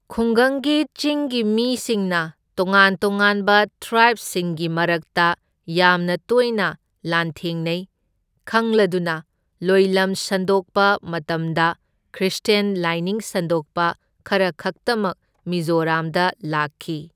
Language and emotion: Manipuri, neutral